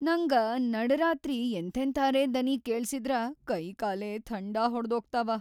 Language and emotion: Kannada, fearful